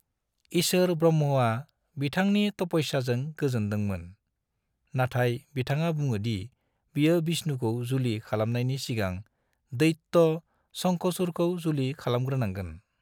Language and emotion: Bodo, neutral